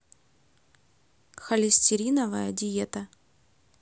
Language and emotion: Russian, neutral